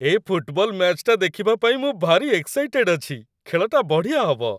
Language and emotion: Odia, happy